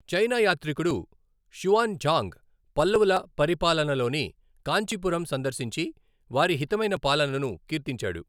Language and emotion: Telugu, neutral